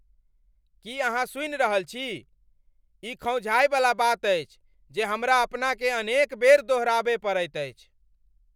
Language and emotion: Maithili, angry